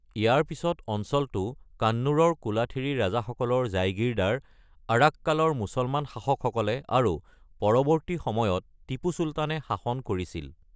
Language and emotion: Assamese, neutral